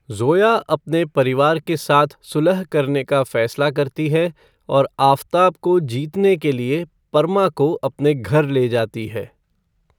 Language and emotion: Hindi, neutral